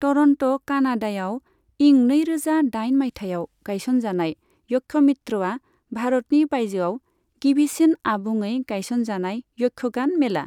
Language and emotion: Bodo, neutral